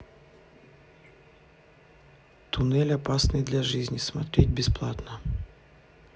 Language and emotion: Russian, neutral